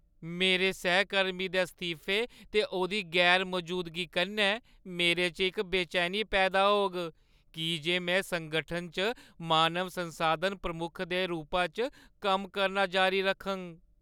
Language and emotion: Dogri, sad